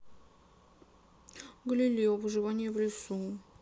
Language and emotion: Russian, sad